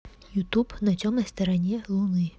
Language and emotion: Russian, neutral